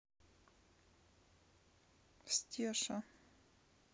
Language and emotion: Russian, neutral